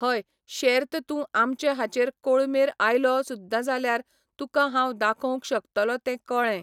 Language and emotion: Goan Konkani, neutral